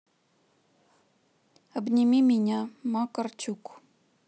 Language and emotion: Russian, neutral